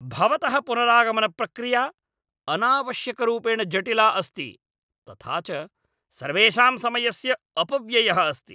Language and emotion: Sanskrit, angry